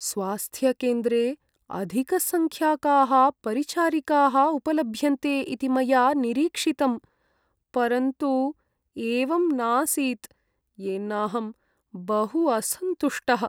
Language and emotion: Sanskrit, sad